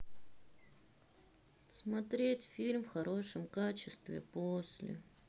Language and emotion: Russian, sad